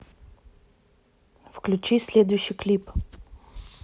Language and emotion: Russian, neutral